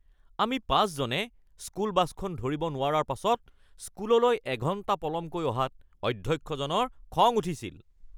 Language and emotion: Assamese, angry